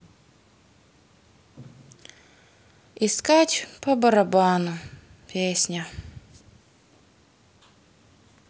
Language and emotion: Russian, sad